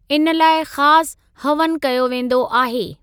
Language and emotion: Sindhi, neutral